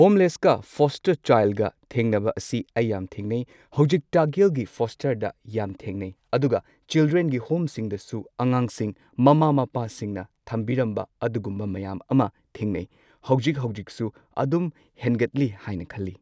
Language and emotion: Manipuri, neutral